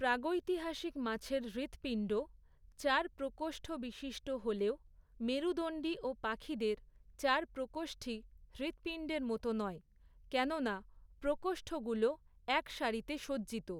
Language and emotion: Bengali, neutral